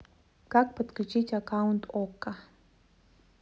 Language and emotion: Russian, neutral